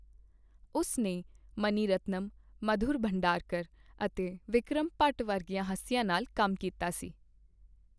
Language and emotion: Punjabi, neutral